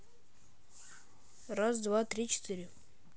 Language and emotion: Russian, neutral